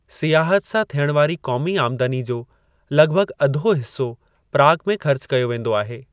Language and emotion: Sindhi, neutral